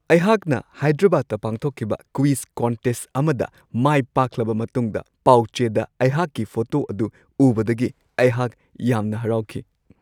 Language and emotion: Manipuri, happy